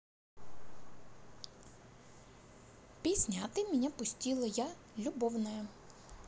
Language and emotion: Russian, positive